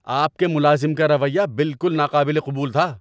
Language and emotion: Urdu, angry